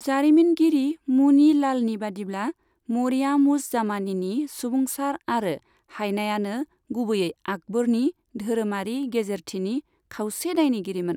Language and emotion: Bodo, neutral